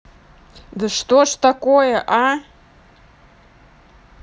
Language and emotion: Russian, angry